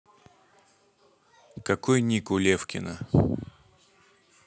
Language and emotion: Russian, neutral